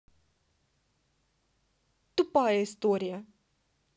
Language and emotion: Russian, neutral